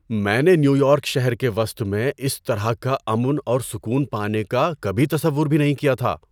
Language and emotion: Urdu, surprised